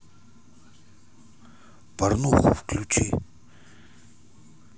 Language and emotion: Russian, neutral